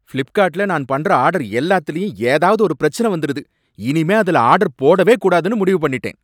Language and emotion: Tamil, angry